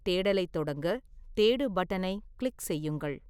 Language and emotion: Tamil, neutral